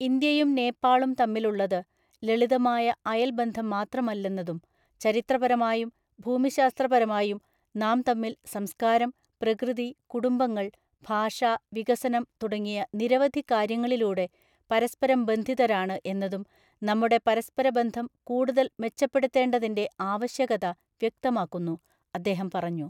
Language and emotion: Malayalam, neutral